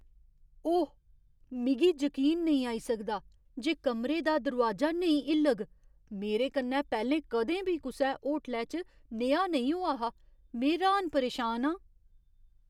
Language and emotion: Dogri, surprised